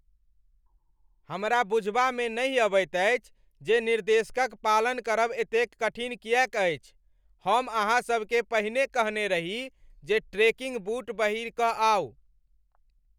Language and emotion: Maithili, angry